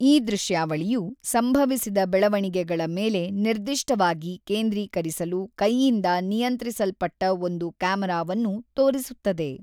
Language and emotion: Kannada, neutral